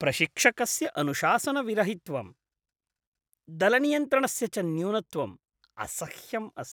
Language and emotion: Sanskrit, disgusted